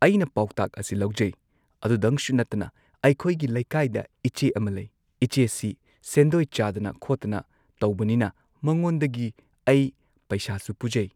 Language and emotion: Manipuri, neutral